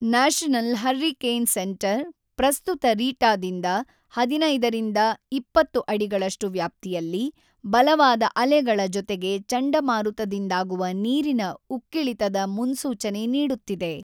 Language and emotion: Kannada, neutral